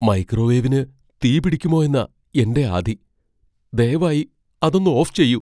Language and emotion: Malayalam, fearful